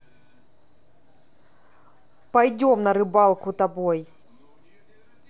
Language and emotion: Russian, neutral